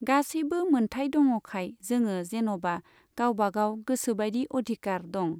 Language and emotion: Bodo, neutral